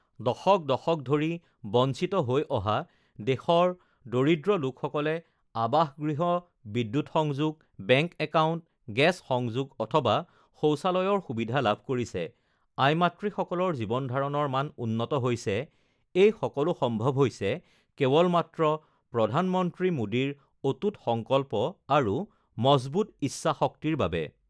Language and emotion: Assamese, neutral